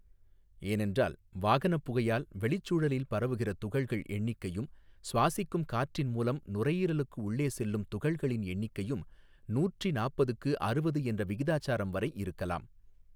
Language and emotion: Tamil, neutral